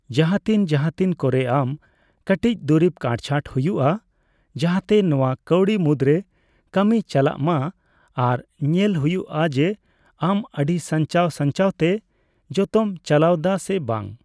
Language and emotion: Santali, neutral